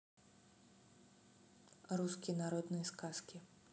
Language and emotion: Russian, neutral